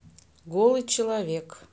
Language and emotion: Russian, neutral